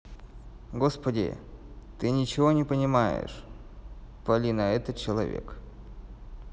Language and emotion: Russian, neutral